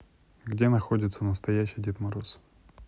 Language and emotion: Russian, neutral